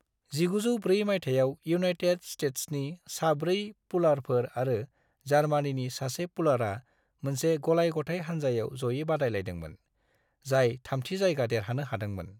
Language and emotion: Bodo, neutral